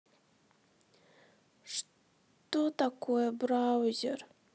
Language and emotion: Russian, sad